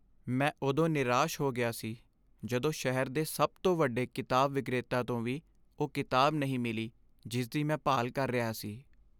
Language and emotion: Punjabi, sad